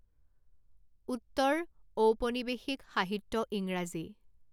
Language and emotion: Assamese, neutral